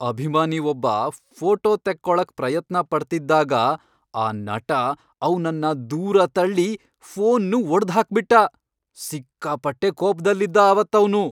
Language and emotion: Kannada, angry